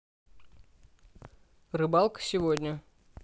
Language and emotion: Russian, neutral